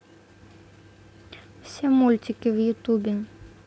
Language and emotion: Russian, neutral